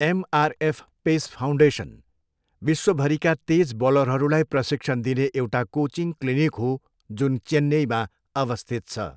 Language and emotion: Nepali, neutral